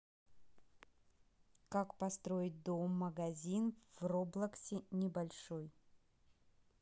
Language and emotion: Russian, neutral